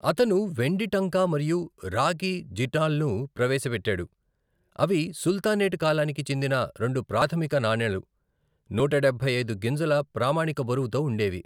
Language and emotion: Telugu, neutral